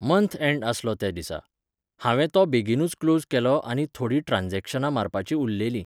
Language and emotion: Goan Konkani, neutral